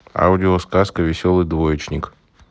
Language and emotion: Russian, neutral